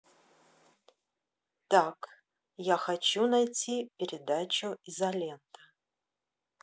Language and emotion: Russian, neutral